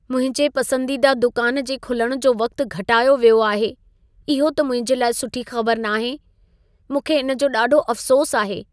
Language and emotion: Sindhi, sad